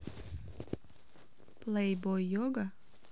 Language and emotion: Russian, neutral